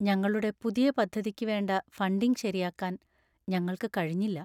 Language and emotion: Malayalam, sad